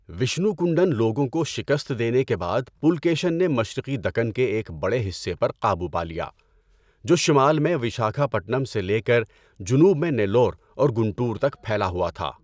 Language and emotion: Urdu, neutral